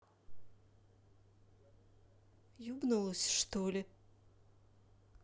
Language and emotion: Russian, angry